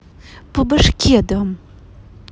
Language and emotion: Russian, angry